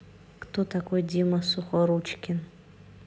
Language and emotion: Russian, neutral